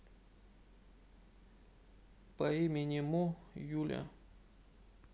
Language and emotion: Russian, sad